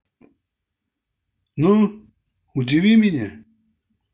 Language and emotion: Russian, angry